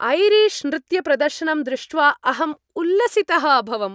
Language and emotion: Sanskrit, happy